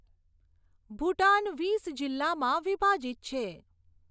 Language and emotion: Gujarati, neutral